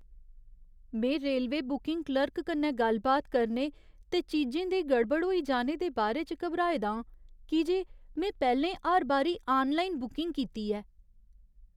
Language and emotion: Dogri, fearful